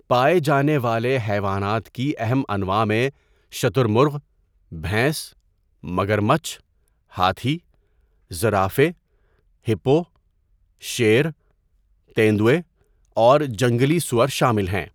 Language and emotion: Urdu, neutral